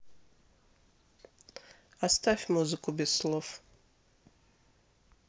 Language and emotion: Russian, neutral